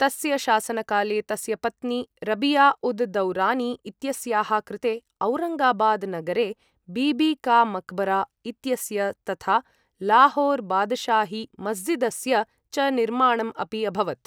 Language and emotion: Sanskrit, neutral